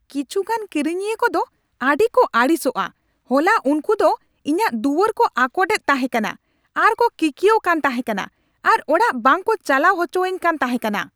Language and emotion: Santali, angry